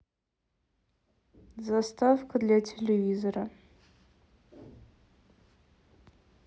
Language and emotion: Russian, neutral